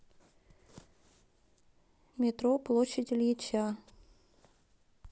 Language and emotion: Russian, neutral